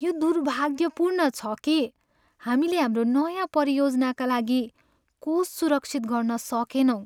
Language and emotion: Nepali, sad